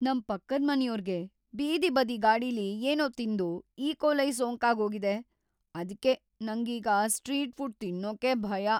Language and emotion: Kannada, fearful